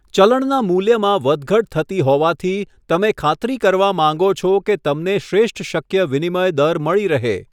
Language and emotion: Gujarati, neutral